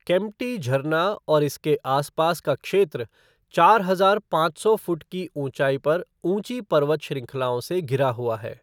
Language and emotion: Hindi, neutral